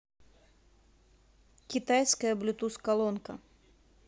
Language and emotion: Russian, neutral